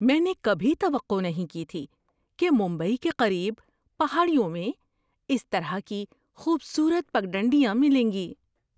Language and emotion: Urdu, surprised